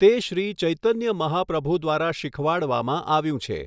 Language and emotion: Gujarati, neutral